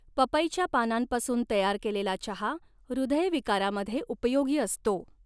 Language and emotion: Marathi, neutral